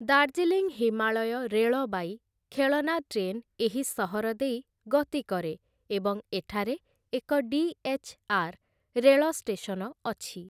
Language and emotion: Odia, neutral